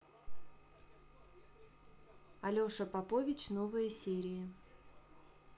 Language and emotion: Russian, neutral